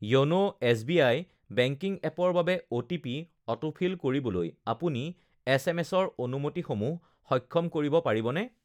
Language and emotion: Assamese, neutral